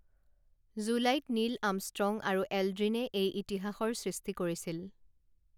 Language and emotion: Assamese, neutral